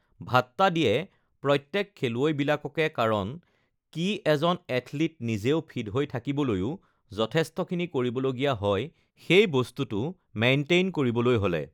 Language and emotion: Assamese, neutral